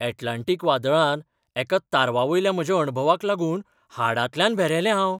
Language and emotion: Goan Konkani, surprised